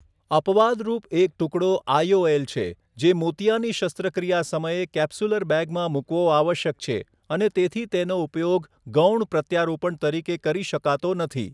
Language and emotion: Gujarati, neutral